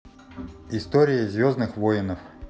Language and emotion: Russian, neutral